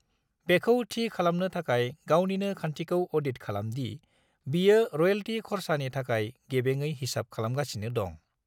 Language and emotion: Bodo, neutral